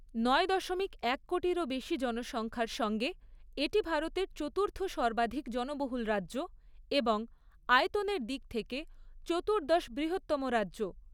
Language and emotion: Bengali, neutral